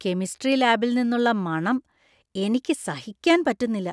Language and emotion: Malayalam, disgusted